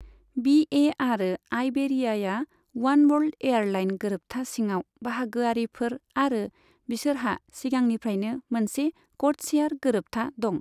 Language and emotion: Bodo, neutral